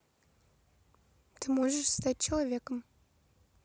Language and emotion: Russian, neutral